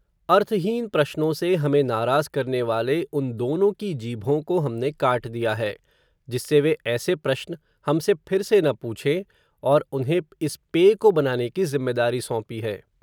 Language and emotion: Hindi, neutral